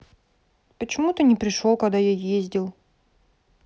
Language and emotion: Russian, sad